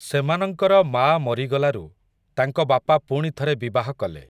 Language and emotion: Odia, neutral